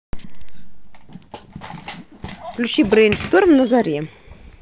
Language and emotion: Russian, neutral